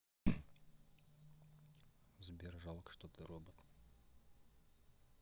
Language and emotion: Russian, neutral